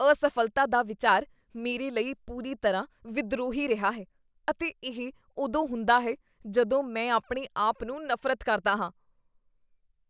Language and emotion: Punjabi, disgusted